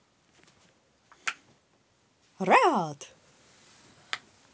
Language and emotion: Russian, positive